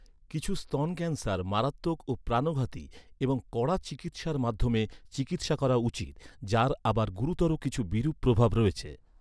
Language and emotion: Bengali, neutral